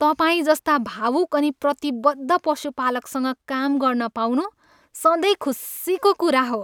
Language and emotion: Nepali, happy